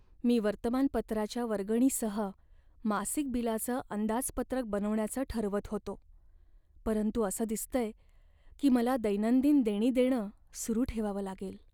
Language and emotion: Marathi, sad